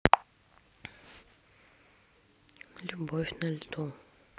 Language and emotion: Russian, sad